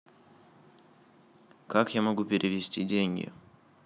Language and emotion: Russian, neutral